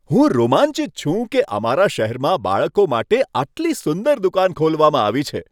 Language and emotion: Gujarati, happy